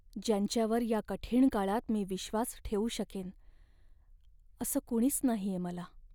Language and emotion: Marathi, sad